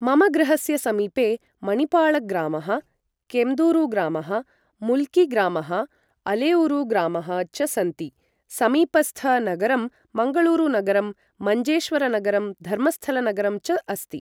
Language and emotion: Sanskrit, neutral